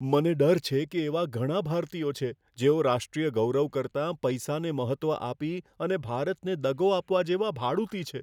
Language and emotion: Gujarati, fearful